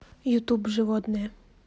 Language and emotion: Russian, neutral